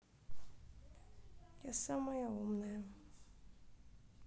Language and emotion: Russian, sad